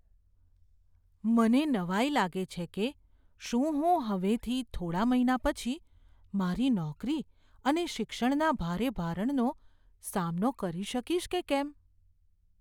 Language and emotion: Gujarati, fearful